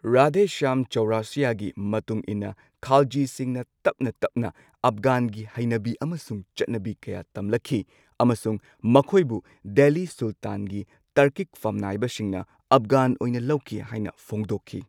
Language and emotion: Manipuri, neutral